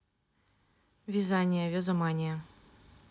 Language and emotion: Russian, neutral